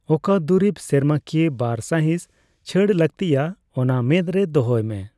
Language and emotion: Santali, neutral